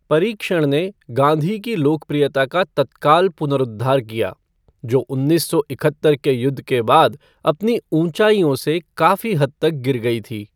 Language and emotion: Hindi, neutral